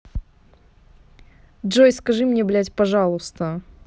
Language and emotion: Russian, angry